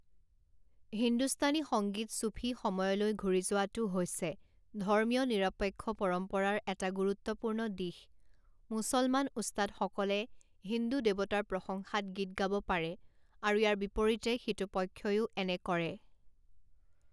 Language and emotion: Assamese, neutral